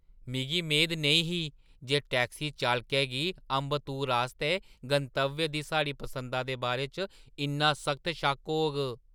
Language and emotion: Dogri, surprised